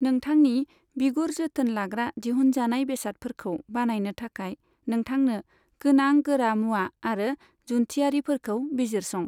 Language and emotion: Bodo, neutral